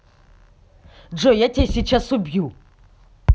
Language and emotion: Russian, angry